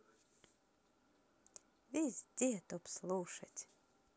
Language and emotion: Russian, positive